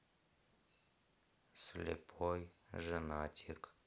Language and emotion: Russian, sad